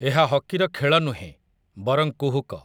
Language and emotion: Odia, neutral